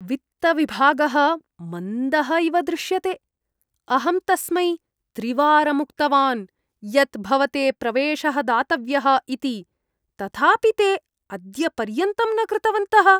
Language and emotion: Sanskrit, disgusted